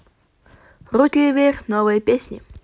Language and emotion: Russian, positive